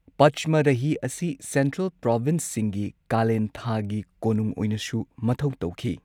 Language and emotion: Manipuri, neutral